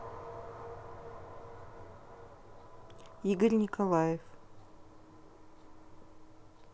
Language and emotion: Russian, neutral